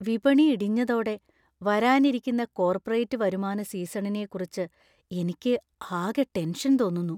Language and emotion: Malayalam, fearful